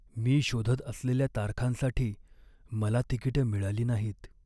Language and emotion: Marathi, sad